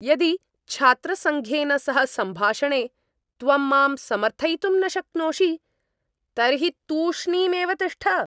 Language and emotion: Sanskrit, angry